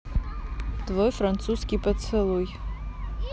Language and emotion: Russian, neutral